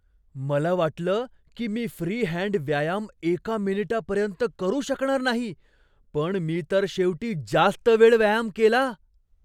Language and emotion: Marathi, surprised